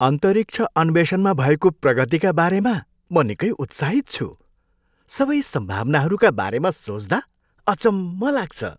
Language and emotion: Nepali, happy